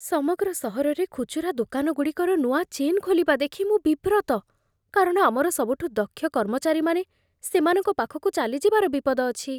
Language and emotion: Odia, fearful